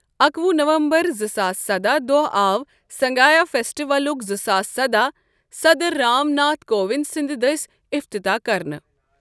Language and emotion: Kashmiri, neutral